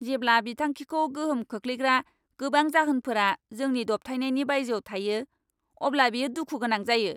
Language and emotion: Bodo, angry